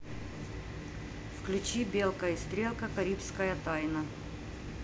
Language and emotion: Russian, neutral